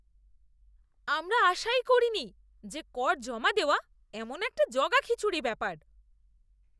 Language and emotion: Bengali, disgusted